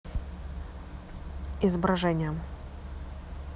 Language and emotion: Russian, neutral